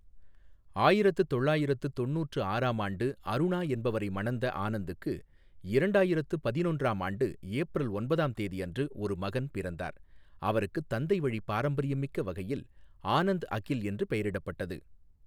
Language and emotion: Tamil, neutral